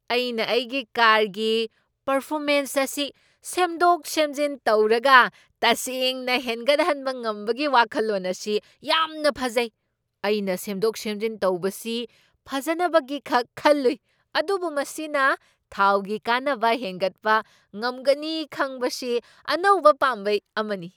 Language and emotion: Manipuri, surprised